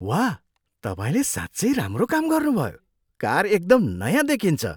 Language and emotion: Nepali, surprised